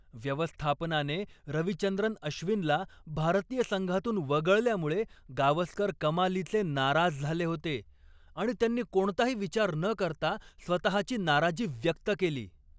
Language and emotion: Marathi, angry